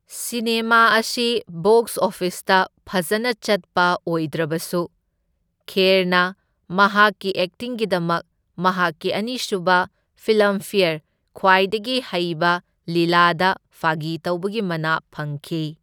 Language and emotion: Manipuri, neutral